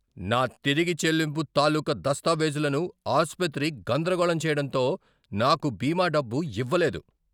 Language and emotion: Telugu, angry